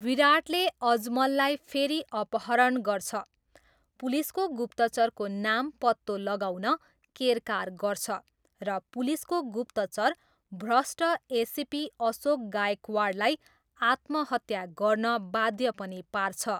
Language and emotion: Nepali, neutral